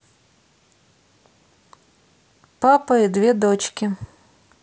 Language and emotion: Russian, neutral